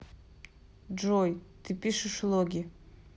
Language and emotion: Russian, neutral